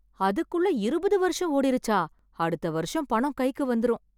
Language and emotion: Tamil, surprised